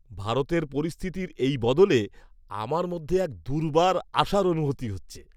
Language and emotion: Bengali, happy